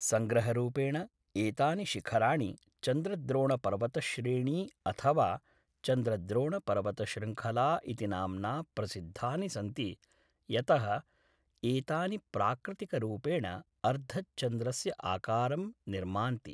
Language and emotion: Sanskrit, neutral